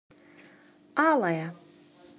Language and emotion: Russian, neutral